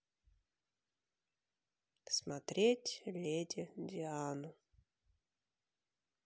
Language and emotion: Russian, sad